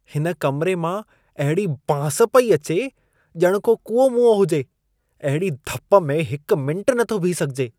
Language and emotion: Sindhi, disgusted